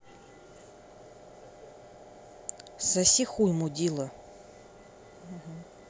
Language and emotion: Russian, angry